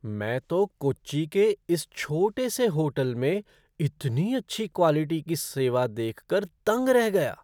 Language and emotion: Hindi, surprised